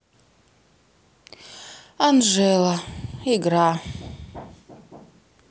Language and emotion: Russian, sad